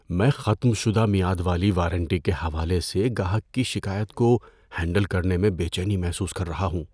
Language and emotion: Urdu, fearful